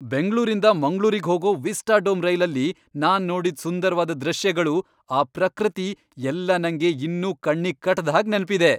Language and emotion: Kannada, happy